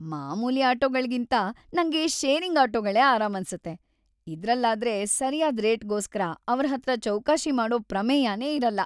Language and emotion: Kannada, happy